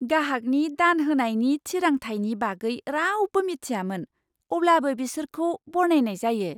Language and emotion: Bodo, surprised